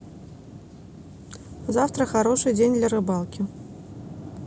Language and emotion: Russian, neutral